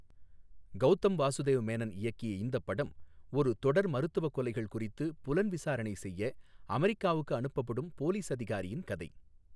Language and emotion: Tamil, neutral